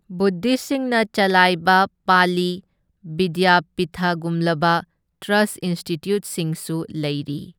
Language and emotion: Manipuri, neutral